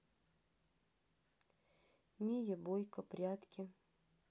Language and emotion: Russian, neutral